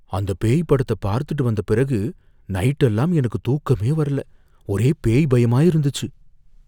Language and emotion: Tamil, fearful